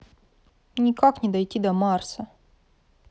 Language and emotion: Russian, sad